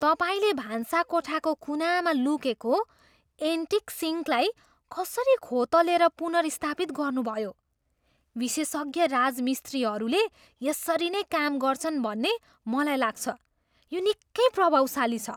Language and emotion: Nepali, surprised